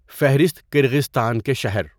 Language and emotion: Urdu, neutral